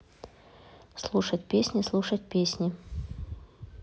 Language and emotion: Russian, neutral